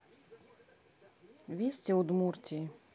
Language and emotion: Russian, neutral